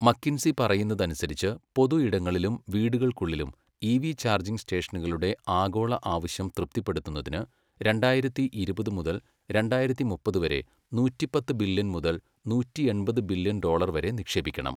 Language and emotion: Malayalam, neutral